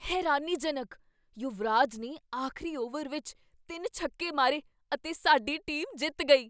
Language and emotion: Punjabi, surprised